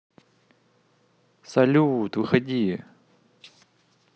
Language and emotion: Russian, positive